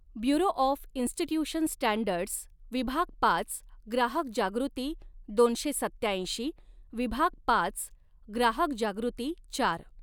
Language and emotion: Marathi, neutral